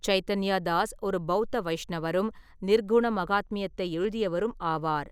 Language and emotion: Tamil, neutral